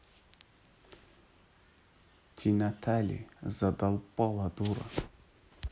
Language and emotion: Russian, neutral